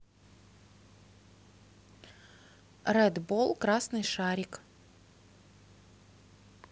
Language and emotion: Russian, neutral